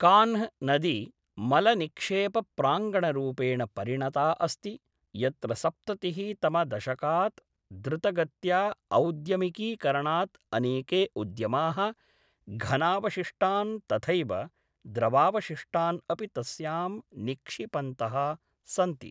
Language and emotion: Sanskrit, neutral